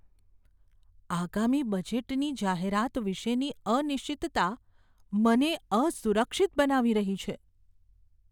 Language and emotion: Gujarati, fearful